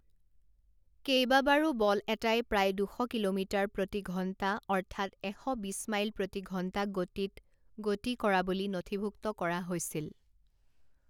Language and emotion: Assamese, neutral